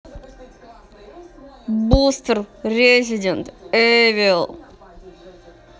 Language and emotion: Russian, neutral